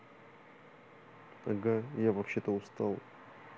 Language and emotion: Russian, sad